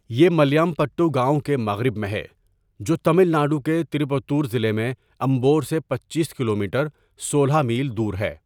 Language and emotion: Urdu, neutral